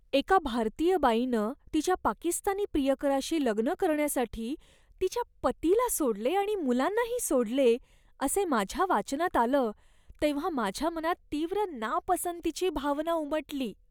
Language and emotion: Marathi, disgusted